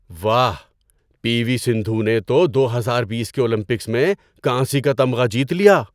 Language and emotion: Urdu, surprised